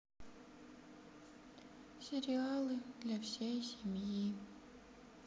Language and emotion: Russian, sad